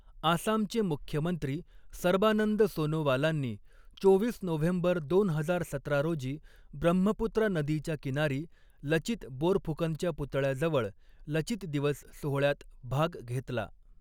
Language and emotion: Marathi, neutral